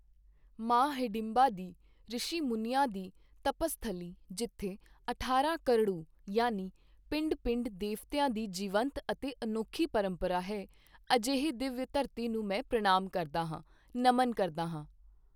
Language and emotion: Punjabi, neutral